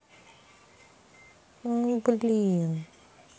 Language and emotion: Russian, sad